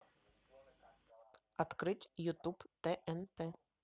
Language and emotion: Russian, neutral